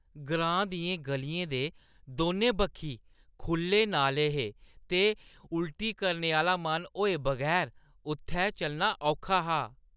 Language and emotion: Dogri, disgusted